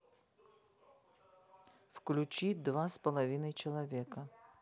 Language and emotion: Russian, neutral